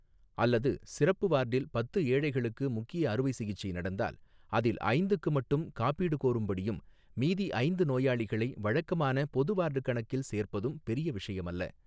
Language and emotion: Tamil, neutral